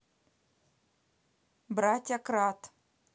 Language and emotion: Russian, neutral